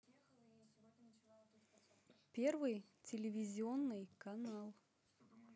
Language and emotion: Russian, neutral